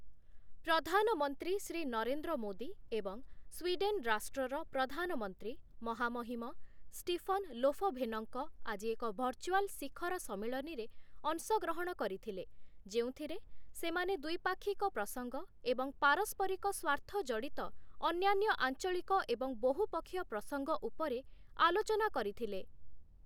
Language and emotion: Odia, neutral